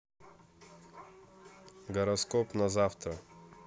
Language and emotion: Russian, neutral